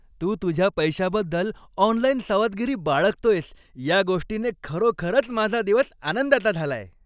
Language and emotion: Marathi, happy